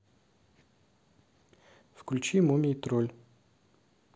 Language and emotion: Russian, neutral